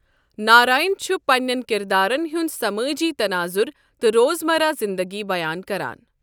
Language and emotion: Kashmiri, neutral